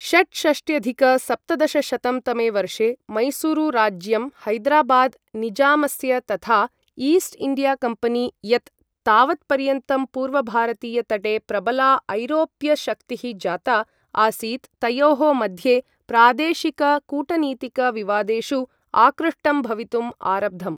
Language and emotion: Sanskrit, neutral